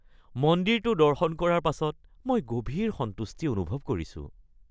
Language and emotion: Assamese, happy